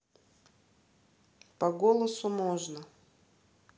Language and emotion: Russian, neutral